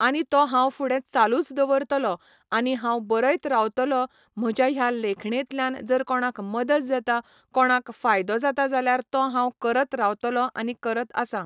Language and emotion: Goan Konkani, neutral